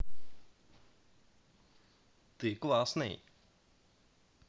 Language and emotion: Russian, positive